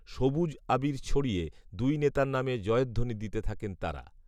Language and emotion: Bengali, neutral